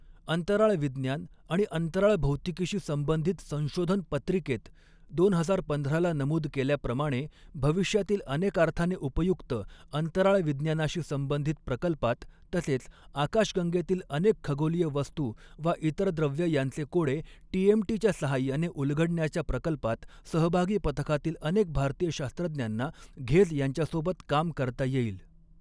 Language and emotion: Marathi, neutral